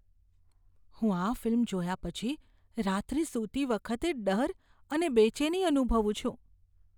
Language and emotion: Gujarati, fearful